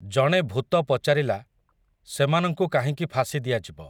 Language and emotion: Odia, neutral